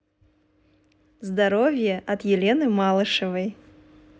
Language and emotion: Russian, positive